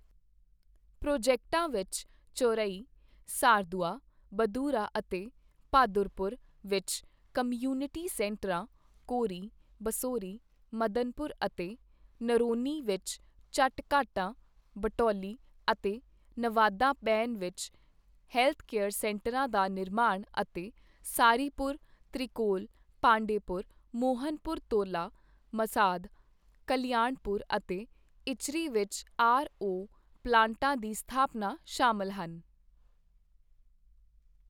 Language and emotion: Punjabi, neutral